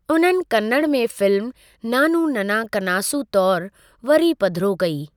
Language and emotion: Sindhi, neutral